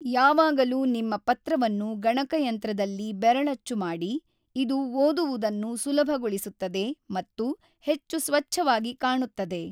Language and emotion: Kannada, neutral